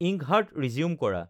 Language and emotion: Assamese, neutral